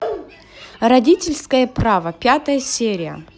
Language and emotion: Russian, positive